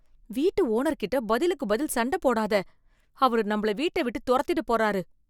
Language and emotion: Tamil, fearful